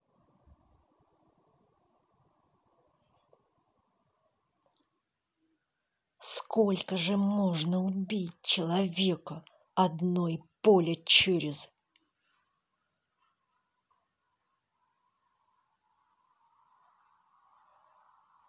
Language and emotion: Russian, angry